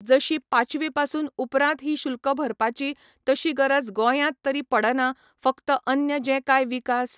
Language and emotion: Goan Konkani, neutral